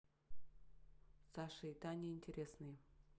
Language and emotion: Russian, neutral